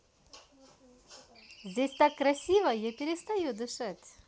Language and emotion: Russian, positive